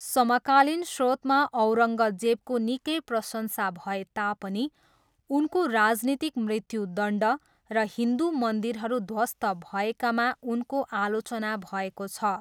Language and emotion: Nepali, neutral